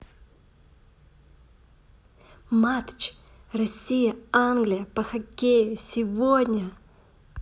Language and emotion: Russian, positive